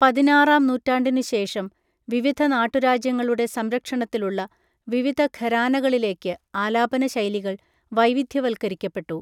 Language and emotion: Malayalam, neutral